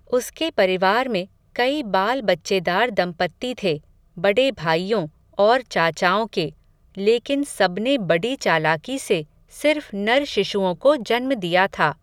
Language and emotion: Hindi, neutral